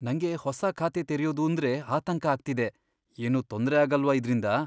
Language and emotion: Kannada, fearful